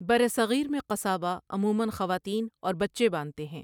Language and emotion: Urdu, neutral